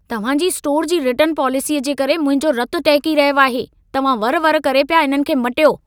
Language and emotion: Sindhi, angry